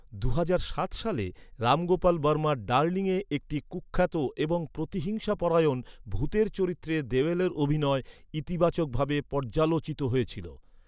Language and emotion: Bengali, neutral